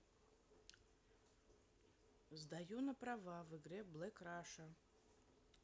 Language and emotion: Russian, neutral